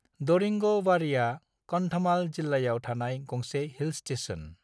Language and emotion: Bodo, neutral